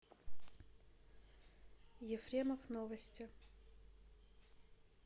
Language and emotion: Russian, neutral